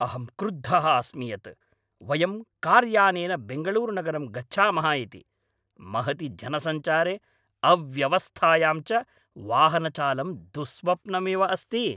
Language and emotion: Sanskrit, angry